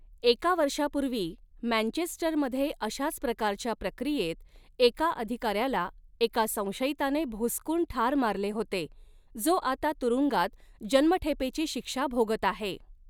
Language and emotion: Marathi, neutral